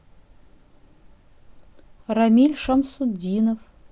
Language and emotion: Russian, neutral